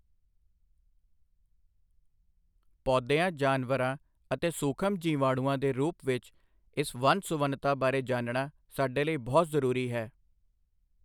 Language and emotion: Punjabi, neutral